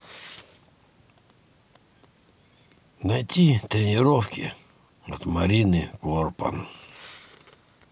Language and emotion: Russian, neutral